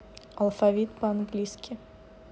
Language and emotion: Russian, neutral